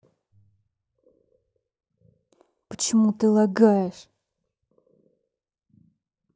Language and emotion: Russian, angry